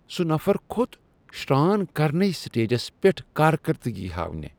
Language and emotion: Kashmiri, disgusted